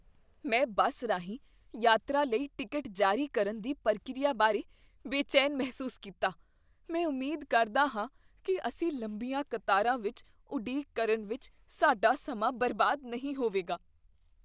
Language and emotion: Punjabi, fearful